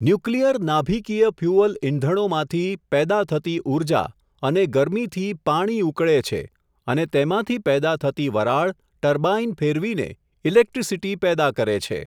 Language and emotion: Gujarati, neutral